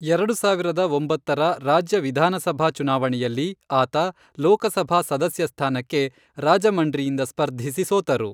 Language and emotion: Kannada, neutral